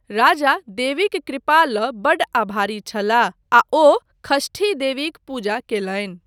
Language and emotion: Maithili, neutral